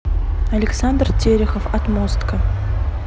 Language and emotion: Russian, neutral